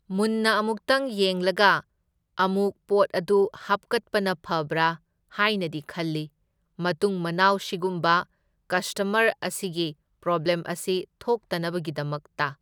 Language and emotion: Manipuri, neutral